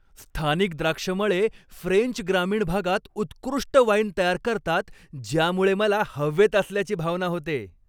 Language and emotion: Marathi, happy